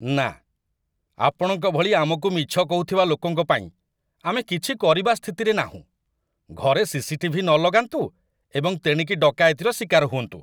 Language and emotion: Odia, disgusted